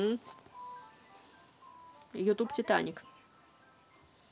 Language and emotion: Russian, neutral